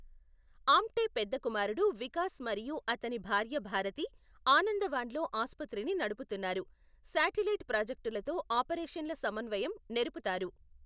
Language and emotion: Telugu, neutral